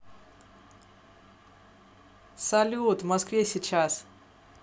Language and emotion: Russian, positive